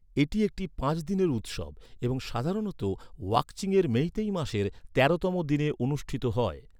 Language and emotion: Bengali, neutral